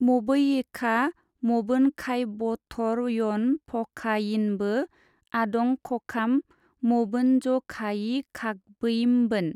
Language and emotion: Bodo, neutral